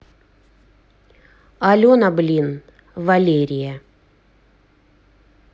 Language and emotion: Russian, angry